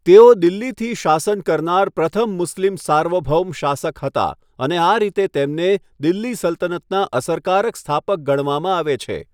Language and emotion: Gujarati, neutral